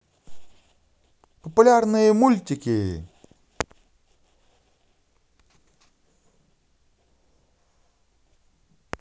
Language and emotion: Russian, positive